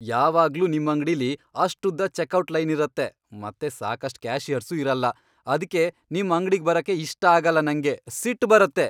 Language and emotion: Kannada, angry